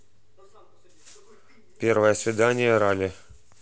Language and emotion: Russian, neutral